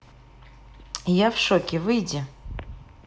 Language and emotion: Russian, neutral